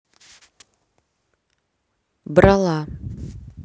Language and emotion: Russian, neutral